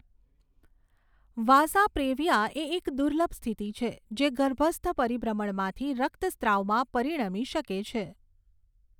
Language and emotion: Gujarati, neutral